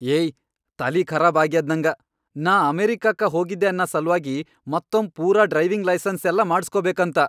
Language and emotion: Kannada, angry